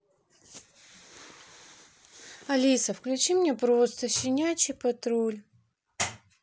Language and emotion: Russian, sad